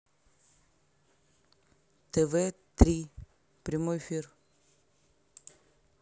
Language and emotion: Russian, neutral